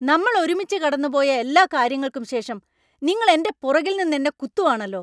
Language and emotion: Malayalam, angry